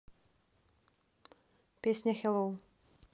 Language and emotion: Russian, neutral